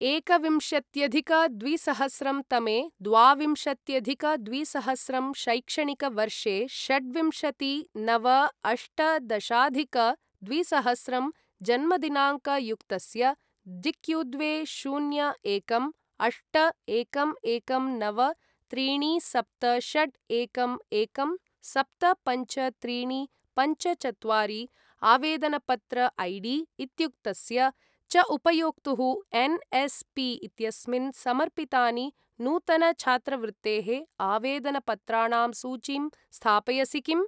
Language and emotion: Sanskrit, neutral